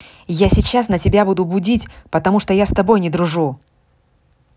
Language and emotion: Russian, angry